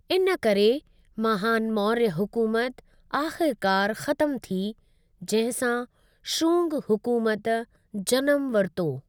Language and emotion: Sindhi, neutral